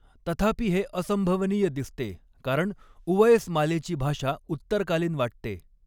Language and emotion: Marathi, neutral